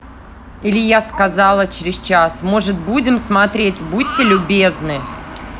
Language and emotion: Russian, angry